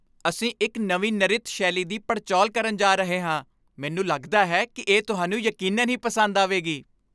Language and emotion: Punjabi, happy